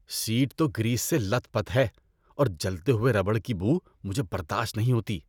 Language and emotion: Urdu, disgusted